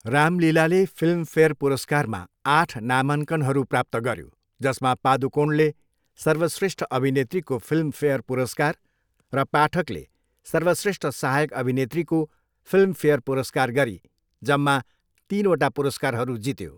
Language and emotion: Nepali, neutral